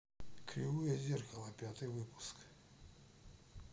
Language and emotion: Russian, neutral